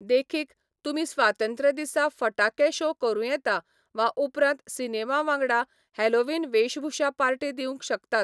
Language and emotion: Goan Konkani, neutral